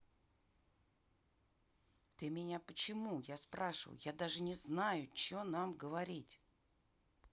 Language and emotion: Russian, angry